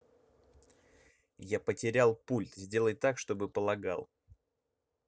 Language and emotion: Russian, angry